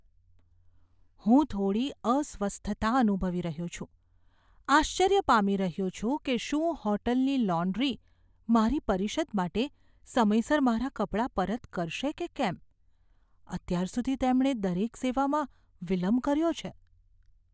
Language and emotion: Gujarati, fearful